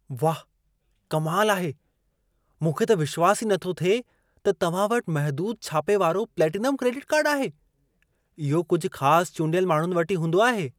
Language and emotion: Sindhi, surprised